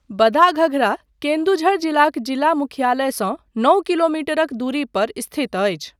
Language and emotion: Maithili, neutral